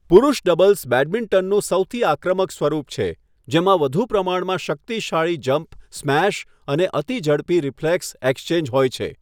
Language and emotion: Gujarati, neutral